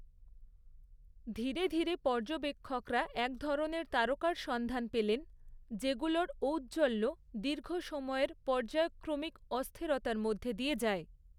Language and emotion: Bengali, neutral